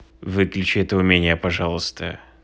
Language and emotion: Russian, angry